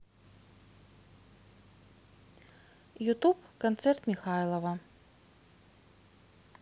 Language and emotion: Russian, neutral